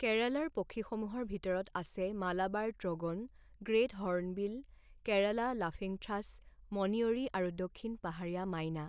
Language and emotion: Assamese, neutral